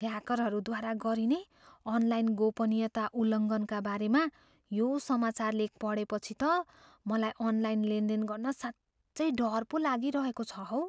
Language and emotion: Nepali, fearful